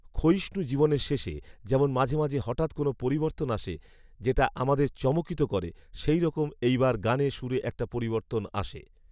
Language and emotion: Bengali, neutral